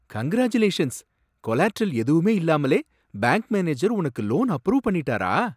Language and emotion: Tamil, surprised